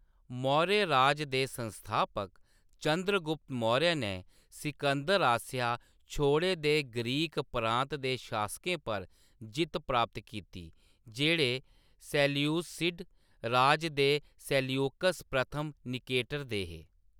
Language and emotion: Dogri, neutral